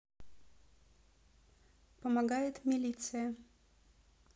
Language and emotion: Russian, neutral